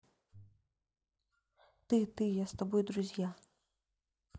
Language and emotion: Russian, neutral